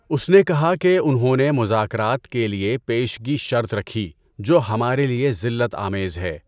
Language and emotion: Urdu, neutral